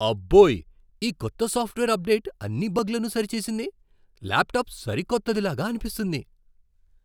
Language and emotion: Telugu, surprised